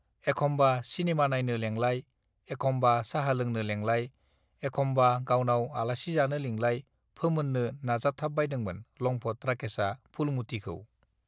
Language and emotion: Bodo, neutral